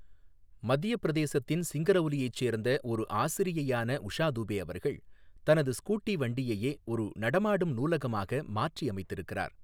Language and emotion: Tamil, neutral